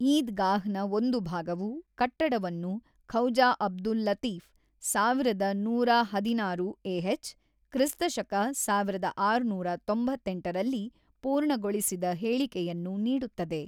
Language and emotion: Kannada, neutral